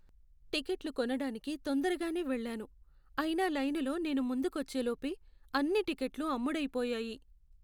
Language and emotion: Telugu, sad